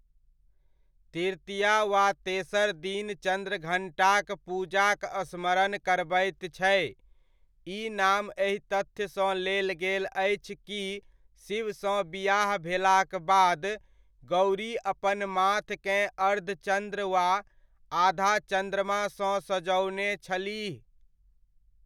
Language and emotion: Maithili, neutral